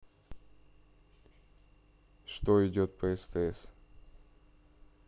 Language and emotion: Russian, neutral